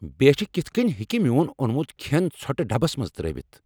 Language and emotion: Kashmiri, angry